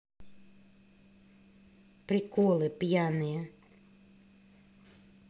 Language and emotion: Russian, neutral